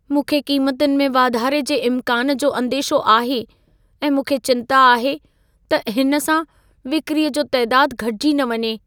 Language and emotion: Sindhi, fearful